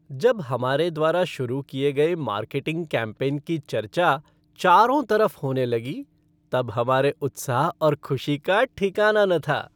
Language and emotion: Hindi, happy